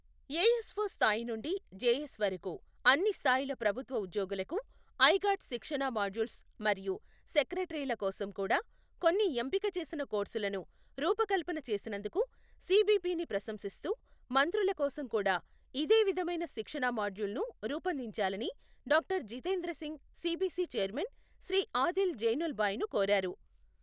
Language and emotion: Telugu, neutral